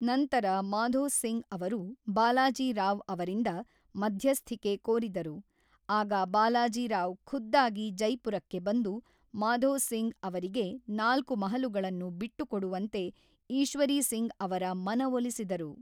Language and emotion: Kannada, neutral